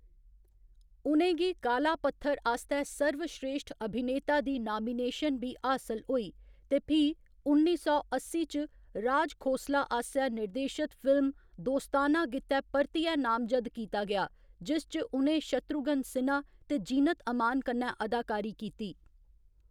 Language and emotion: Dogri, neutral